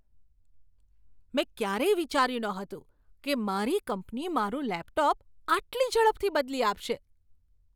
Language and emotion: Gujarati, surprised